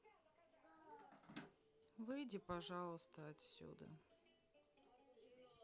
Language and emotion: Russian, sad